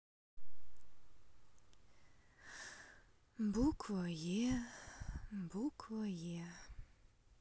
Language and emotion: Russian, sad